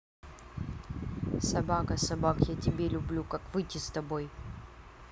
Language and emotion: Russian, neutral